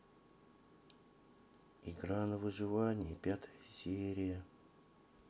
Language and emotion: Russian, sad